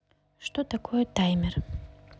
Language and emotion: Russian, neutral